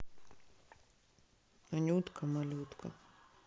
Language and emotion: Russian, neutral